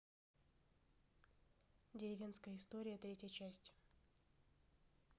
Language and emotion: Russian, neutral